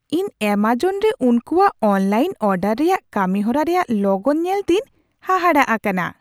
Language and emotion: Santali, surprised